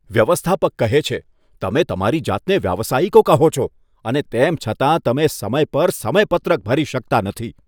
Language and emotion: Gujarati, disgusted